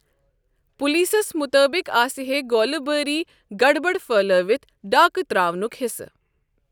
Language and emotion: Kashmiri, neutral